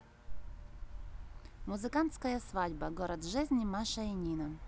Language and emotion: Russian, neutral